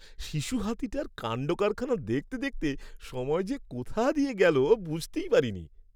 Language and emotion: Bengali, happy